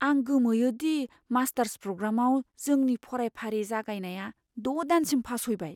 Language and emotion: Bodo, fearful